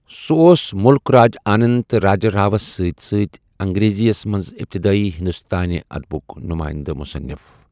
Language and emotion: Kashmiri, neutral